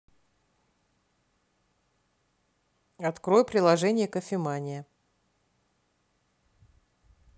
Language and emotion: Russian, neutral